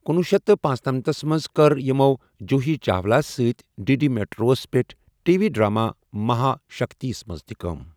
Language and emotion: Kashmiri, neutral